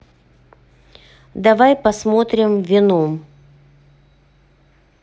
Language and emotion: Russian, neutral